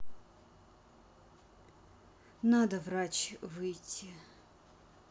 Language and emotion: Russian, sad